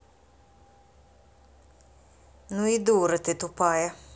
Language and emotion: Russian, angry